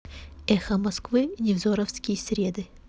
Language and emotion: Russian, neutral